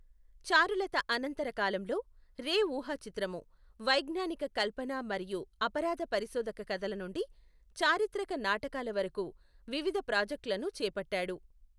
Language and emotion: Telugu, neutral